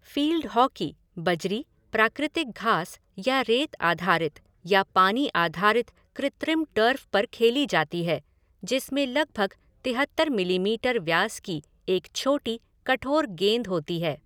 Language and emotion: Hindi, neutral